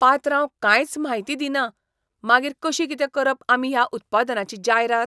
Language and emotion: Goan Konkani, disgusted